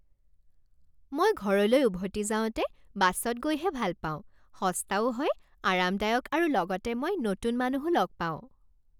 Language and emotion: Assamese, happy